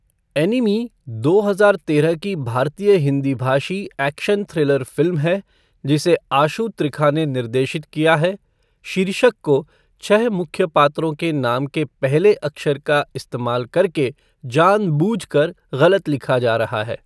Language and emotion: Hindi, neutral